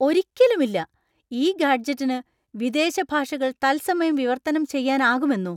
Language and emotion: Malayalam, surprised